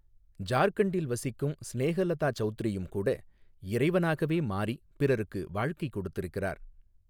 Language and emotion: Tamil, neutral